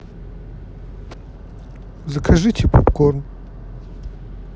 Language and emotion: Russian, neutral